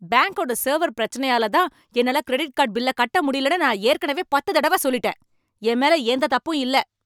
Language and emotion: Tamil, angry